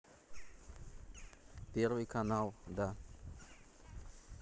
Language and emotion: Russian, neutral